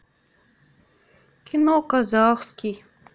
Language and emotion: Russian, sad